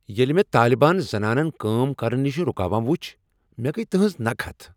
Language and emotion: Kashmiri, angry